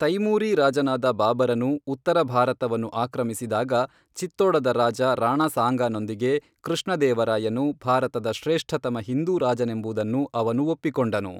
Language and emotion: Kannada, neutral